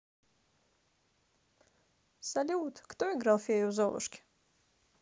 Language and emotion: Russian, positive